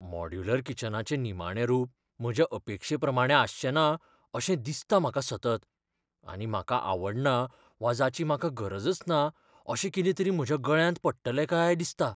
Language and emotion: Goan Konkani, fearful